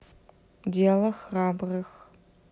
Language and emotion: Russian, neutral